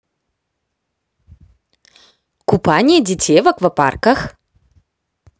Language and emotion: Russian, positive